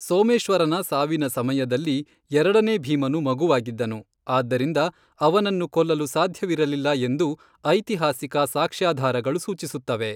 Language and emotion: Kannada, neutral